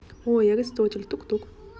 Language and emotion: Russian, neutral